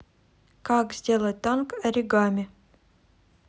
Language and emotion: Russian, neutral